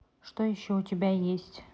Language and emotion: Russian, neutral